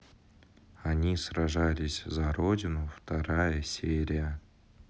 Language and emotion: Russian, neutral